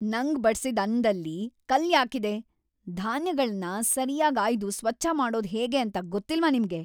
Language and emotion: Kannada, angry